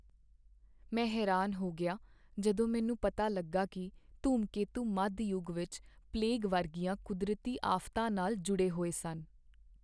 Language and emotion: Punjabi, sad